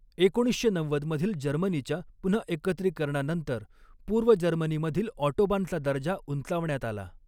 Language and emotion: Marathi, neutral